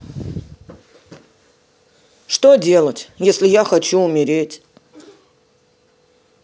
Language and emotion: Russian, sad